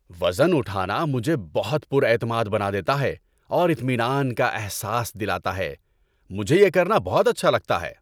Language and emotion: Urdu, happy